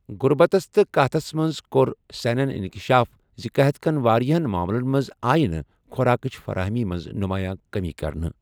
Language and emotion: Kashmiri, neutral